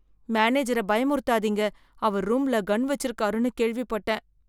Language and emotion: Tamil, fearful